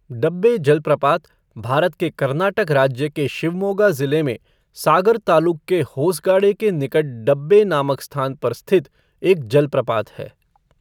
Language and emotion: Hindi, neutral